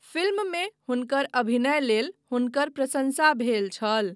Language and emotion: Maithili, neutral